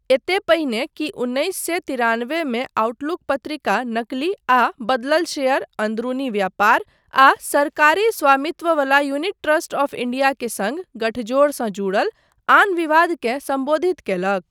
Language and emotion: Maithili, neutral